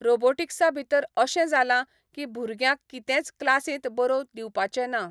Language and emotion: Goan Konkani, neutral